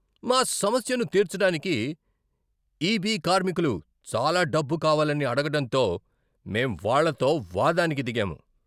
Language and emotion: Telugu, angry